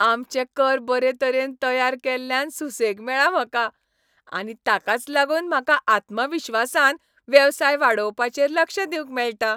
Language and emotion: Goan Konkani, happy